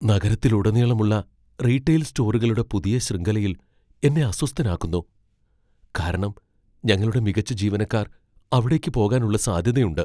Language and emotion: Malayalam, fearful